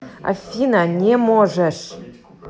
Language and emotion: Russian, angry